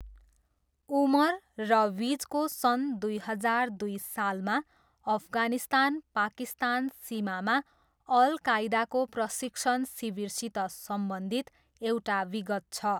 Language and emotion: Nepali, neutral